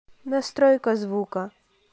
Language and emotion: Russian, neutral